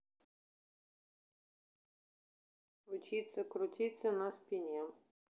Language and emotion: Russian, neutral